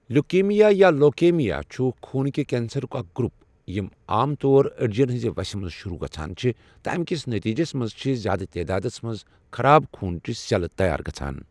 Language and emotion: Kashmiri, neutral